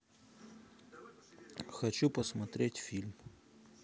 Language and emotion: Russian, neutral